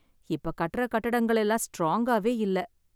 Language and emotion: Tamil, sad